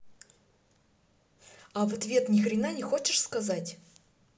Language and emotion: Russian, angry